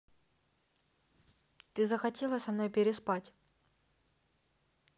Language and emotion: Russian, neutral